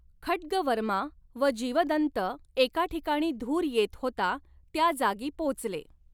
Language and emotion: Marathi, neutral